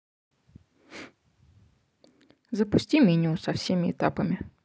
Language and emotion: Russian, neutral